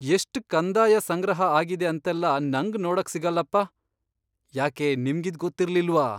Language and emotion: Kannada, surprised